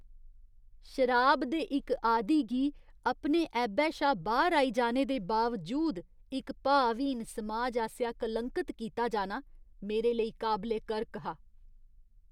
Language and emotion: Dogri, disgusted